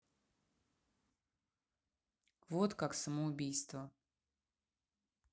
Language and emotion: Russian, neutral